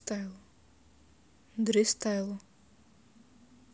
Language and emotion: Russian, neutral